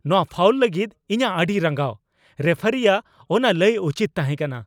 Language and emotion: Santali, angry